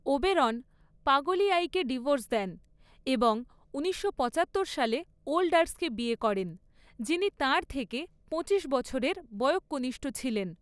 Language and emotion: Bengali, neutral